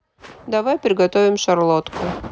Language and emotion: Russian, neutral